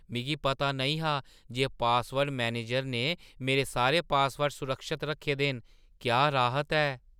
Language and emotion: Dogri, surprised